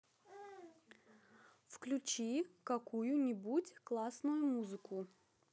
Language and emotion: Russian, neutral